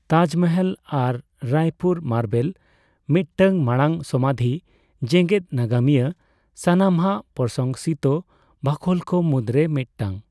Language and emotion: Santali, neutral